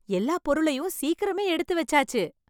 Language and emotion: Tamil, happy